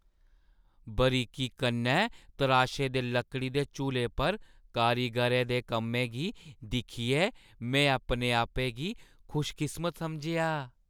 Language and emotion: Dogri, happy